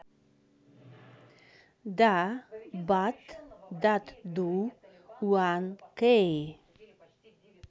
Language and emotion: Russian, neutral